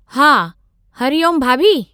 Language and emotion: Sindhi, neutral